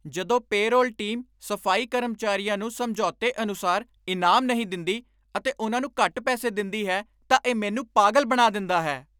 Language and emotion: Punjabi, angry